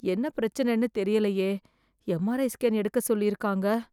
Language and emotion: Tamil, fearful